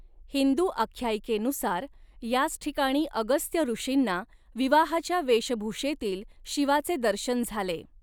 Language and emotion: Marathi, neutral